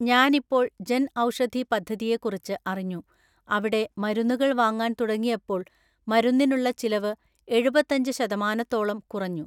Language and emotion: Malayalam, neutral